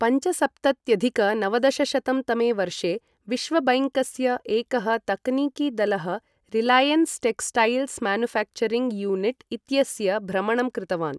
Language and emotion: Sanskrit, neutral